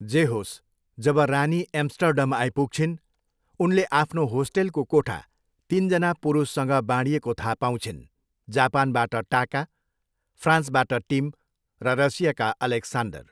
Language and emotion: Nepali, neutral